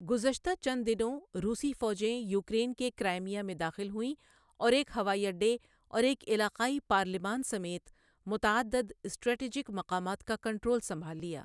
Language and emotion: Urdu, neutral